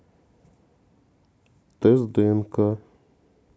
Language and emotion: Russian, sad